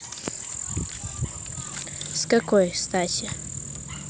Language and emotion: Russian, neutral